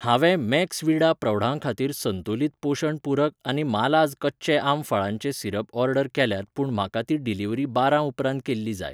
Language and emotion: Goan Konkani, neutral